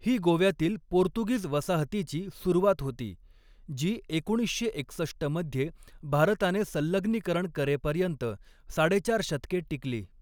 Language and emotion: Marathi, neutral